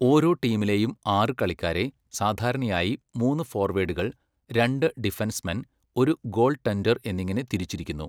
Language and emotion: Malayalam, neutral